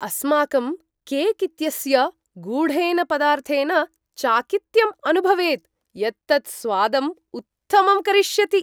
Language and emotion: Sanskrit, surprised